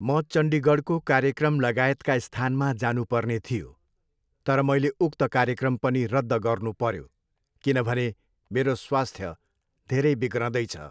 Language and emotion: Nepali, neutral